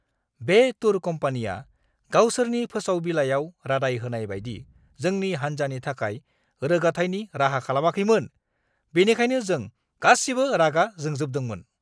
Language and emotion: Bodo, angry